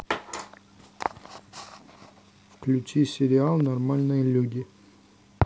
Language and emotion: Russian, neutral